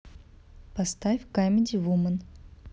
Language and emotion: Russian, neutral